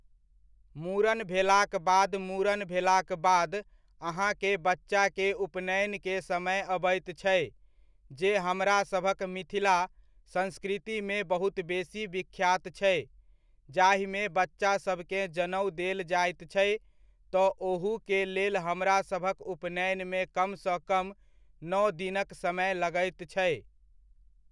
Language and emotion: Maithili, neutral